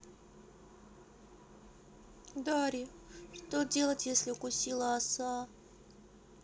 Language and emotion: Russian, sad